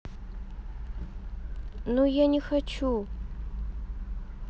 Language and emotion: Russian, sad